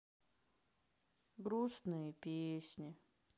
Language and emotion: Russian, sad